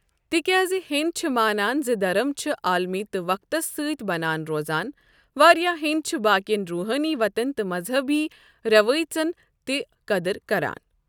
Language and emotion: Kashmiri, neutral